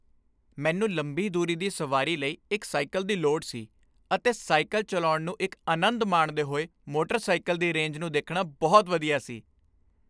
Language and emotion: Punjabi, happy